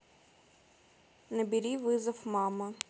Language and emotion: Russian, neutral